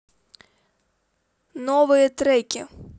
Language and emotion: Russian, neutral